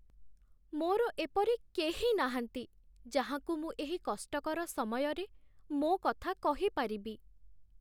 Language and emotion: Odia, sad